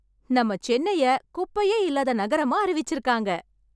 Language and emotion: Tamil, happy